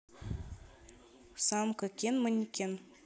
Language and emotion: Russian, neutral